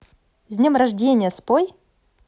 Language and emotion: Russian, positive